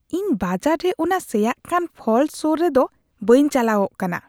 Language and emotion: Santali, disgusted